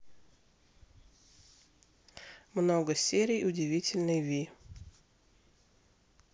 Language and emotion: Russian, neutral